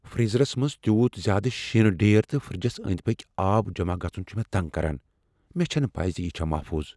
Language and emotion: Kashmiri, fearful